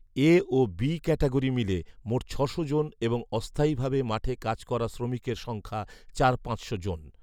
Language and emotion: Bengali, neutral